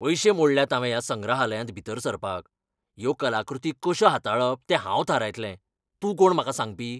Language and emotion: Goan Konkani, angry